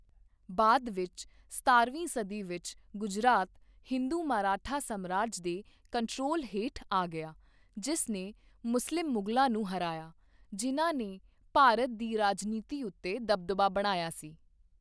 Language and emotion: Punjabi, neutral